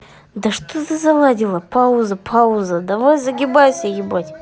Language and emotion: Russian, angry